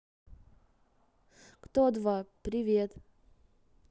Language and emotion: Russian, neutral